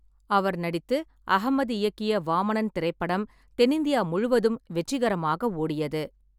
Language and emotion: Tamil, neutral